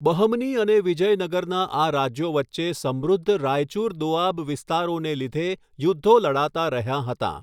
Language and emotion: Gujarati, neutral